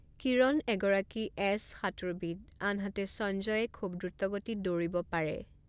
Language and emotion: Assamese, neutral